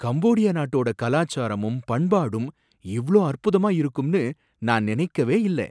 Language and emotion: Tamil, surprised